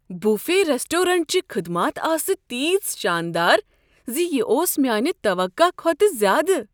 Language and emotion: Kashmiri, surprised